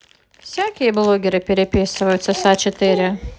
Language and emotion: Russian, neutral